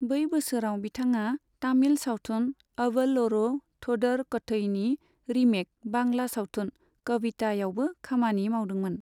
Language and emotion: Bodo, neutral